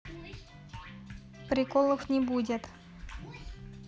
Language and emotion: Russian, neutral